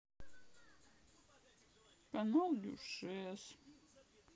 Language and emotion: Russian, sad